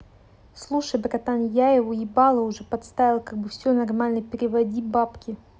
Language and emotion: Russian, neutral